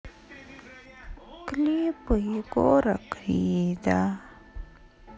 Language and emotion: Russian, sad